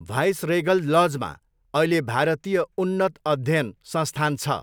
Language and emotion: Nepali, neutral